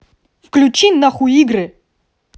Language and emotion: Russian, angry